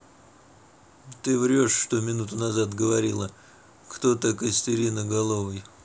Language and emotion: Russian, neutral